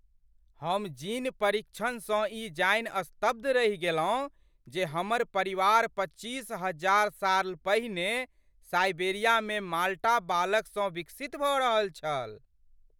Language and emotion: Maithili, surprised